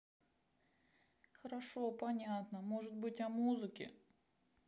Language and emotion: Russian, sad